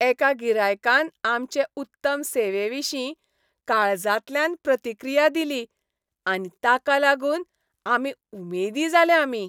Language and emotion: Goan Konkani, happy